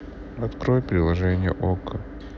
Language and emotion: Russian, sad